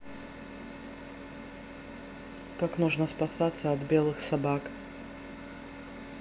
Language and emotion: Russian, neutral